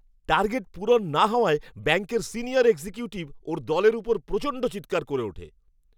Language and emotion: Bengali, angry